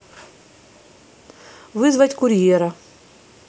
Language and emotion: Russian, neutral